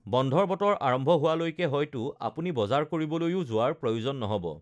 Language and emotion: Assamese, neutral